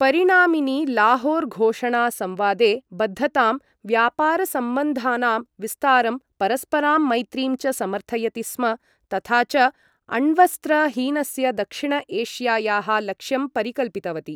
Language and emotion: Sanskrit, neutral